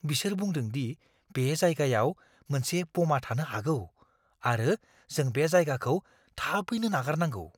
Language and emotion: Bodo, fearful